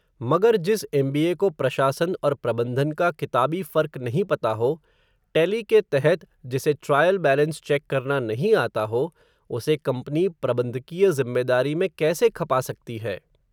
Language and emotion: Hindi, neutral